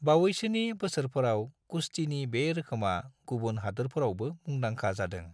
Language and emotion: Bodo, neutral